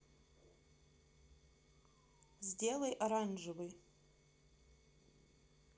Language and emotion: Russian, neutral